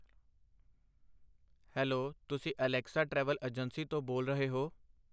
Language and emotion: Punjabi, neutral